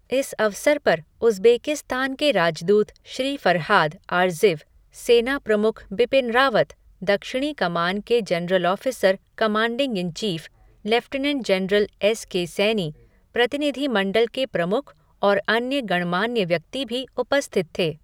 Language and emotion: Hindi, neutral